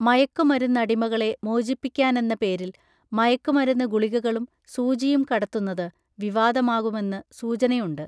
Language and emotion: Malayalam, neutral